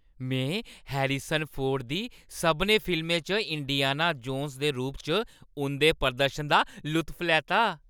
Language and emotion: Dogri, happy